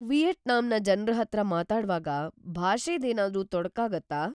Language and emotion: Kannada, fearful